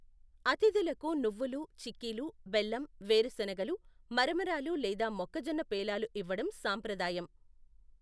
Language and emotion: Telugu, neutral